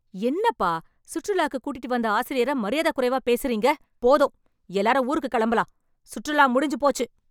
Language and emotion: Tamil, angry